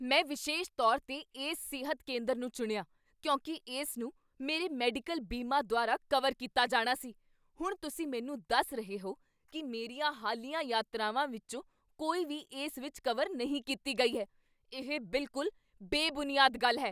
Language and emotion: Punjabi, angry